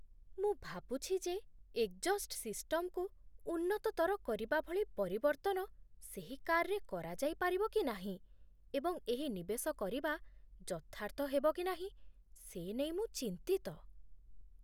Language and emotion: Odia, fearful